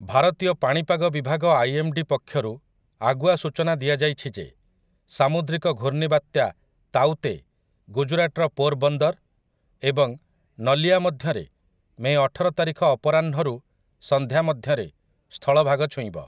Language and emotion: Odia, neutral